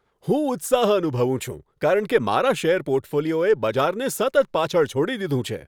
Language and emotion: Gujarati, happy